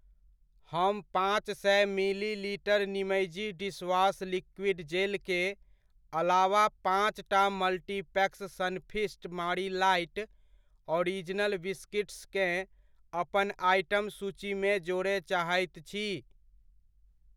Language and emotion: Maithili, neutral